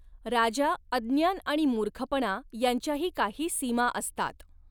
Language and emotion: Marathi, neutral